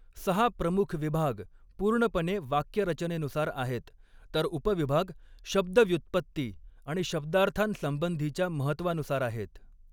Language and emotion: Marathi, neutral